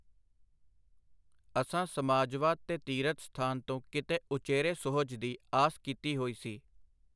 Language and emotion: Punjabi, neutral